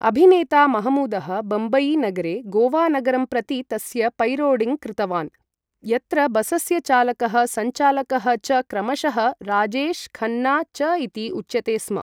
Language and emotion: Sanskrit, neutral